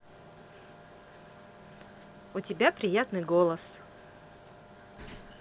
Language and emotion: Russian, positive